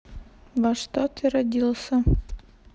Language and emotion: Russian, neutral